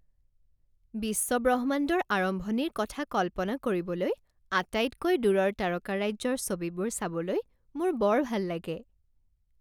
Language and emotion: Assamese, happy